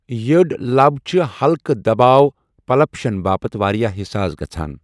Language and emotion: Kashmiri, neutral